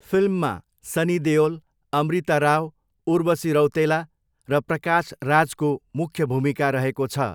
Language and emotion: Nepali, neutral